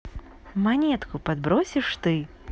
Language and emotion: Russian, positive